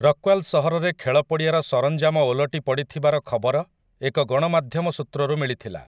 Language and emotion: Odia, neutral